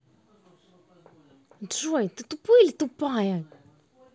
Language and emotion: Russian, angry